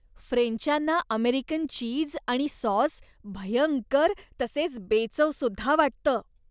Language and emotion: Marathi, disgusted